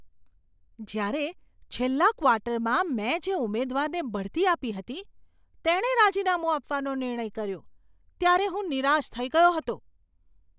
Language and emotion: Gujarati, surprised